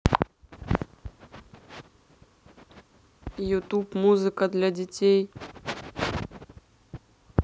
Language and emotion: Russian, neutral